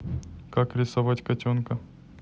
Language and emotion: Russian, neutral